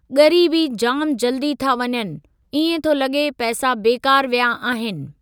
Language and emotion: Sindhi, neutral